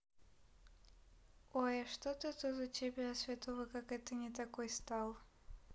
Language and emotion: Russian, neutral